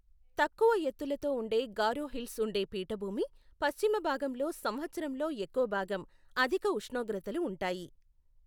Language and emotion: Telugu, neutral